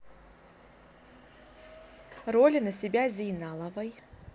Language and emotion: Russian, neutral